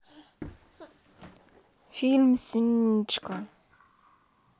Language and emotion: Russian, neutral